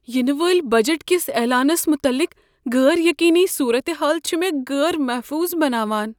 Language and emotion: Kashmiri, fearful